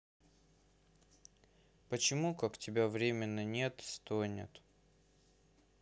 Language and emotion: Russian, sad